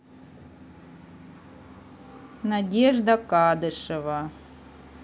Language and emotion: Russian, neutral